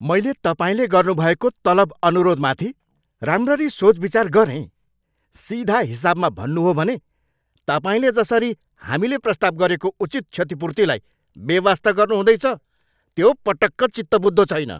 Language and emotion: Nepali, angry